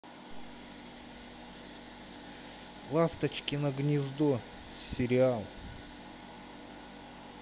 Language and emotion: Russian, neutral